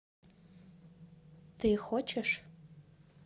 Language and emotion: Russian, neutral